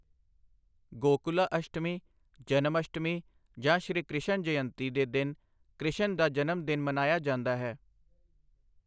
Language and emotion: Punjabi, neutral